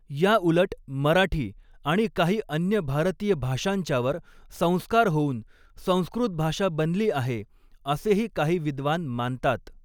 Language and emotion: Marathi, neutral